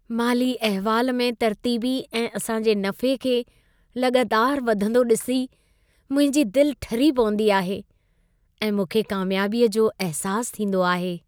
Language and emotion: Sindhi, happy